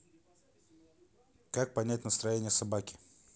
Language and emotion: Russian, neutral